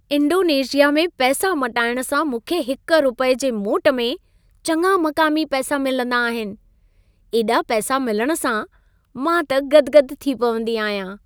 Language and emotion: Sindhi, happy